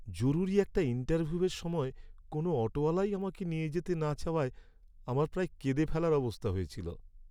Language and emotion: Bengali, sad